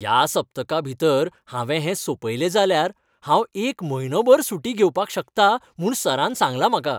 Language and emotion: Goan Konkani, happy